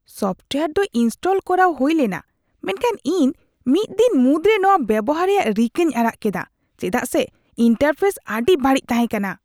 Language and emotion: Santali, disgusted